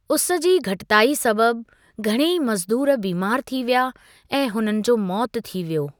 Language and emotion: Sindhi, neutral